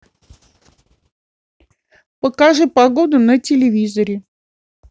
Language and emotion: Russian, neutral